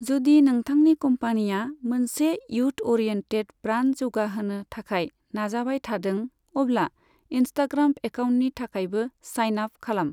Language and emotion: Bodo, neutral